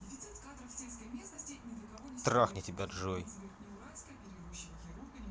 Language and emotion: Russian, angry